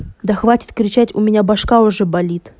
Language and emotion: Russian, angry